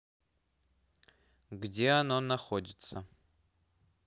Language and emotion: Russian, neutral